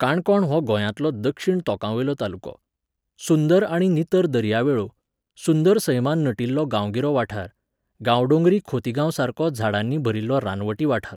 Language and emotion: Goan Konkani, neutral